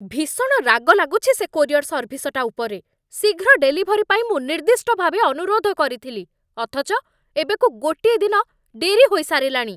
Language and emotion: Odia, angry